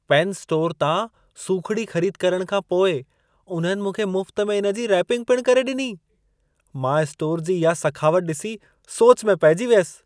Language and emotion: Sindhi, surprised